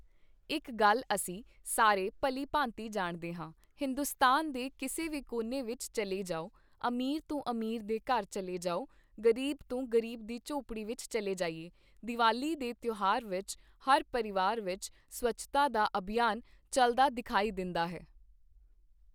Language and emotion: Punjabi, neutral